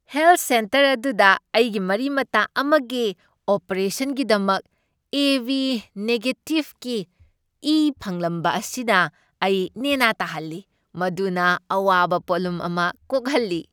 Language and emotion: Manipuri, happy